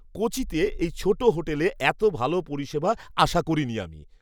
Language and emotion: Bengali, surprised